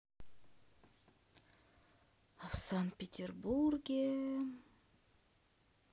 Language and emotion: Russian, sad